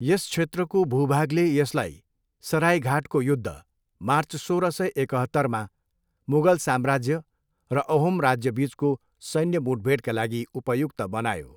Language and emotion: Nepali, neutral